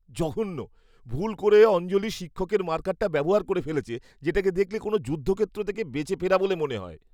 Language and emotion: Bengali, disgusted